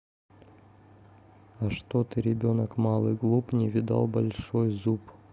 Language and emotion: Russian, neutral